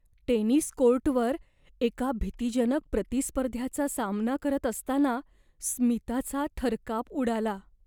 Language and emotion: Marathi, fearful